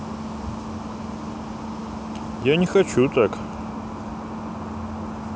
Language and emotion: Russian, neutral